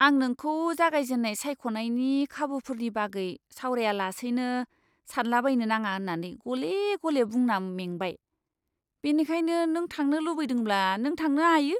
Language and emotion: Bodo, disgusted